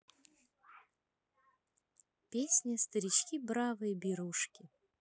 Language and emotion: Russian, neutral